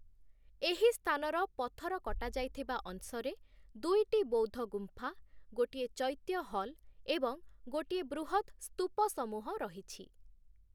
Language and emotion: Odia, neutral